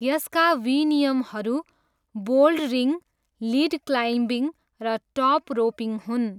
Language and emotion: Nepali, neutral